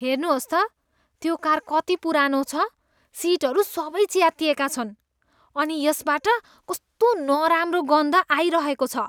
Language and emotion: Nepali, disgusted